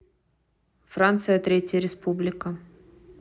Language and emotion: Russian, neutral